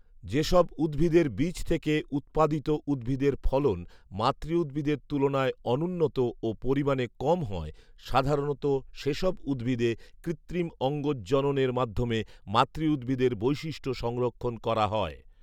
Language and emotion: Bengali, neutral